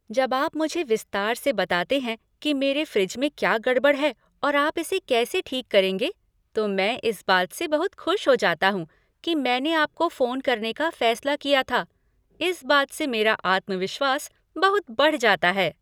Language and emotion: Hindi, happy